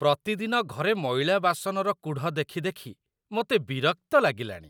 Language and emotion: Odia, disgusted